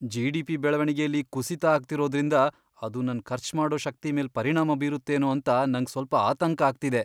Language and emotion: Kannada, fearful